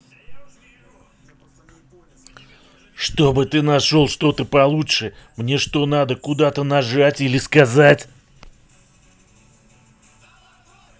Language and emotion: Russian, angry